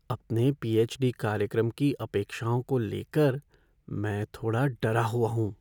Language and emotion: Hindi, fearful